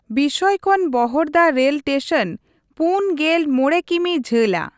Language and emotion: Santali, neutral